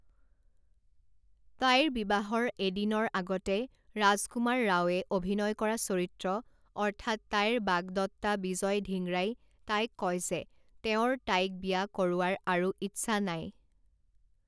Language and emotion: Assamese, neutral